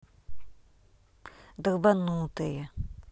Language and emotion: Russian, angry